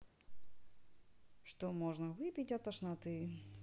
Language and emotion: Russian, neutral